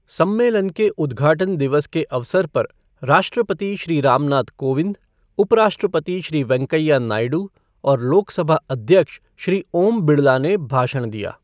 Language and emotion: Hindi, neutral